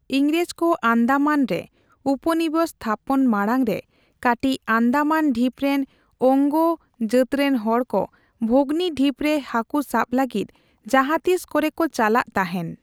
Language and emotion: Santali, neutral